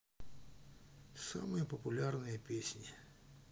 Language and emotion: Russian, neutral